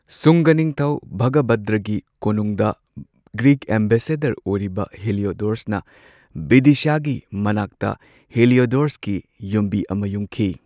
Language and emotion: Manipuri, neutral